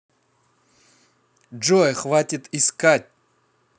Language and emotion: Russian, angry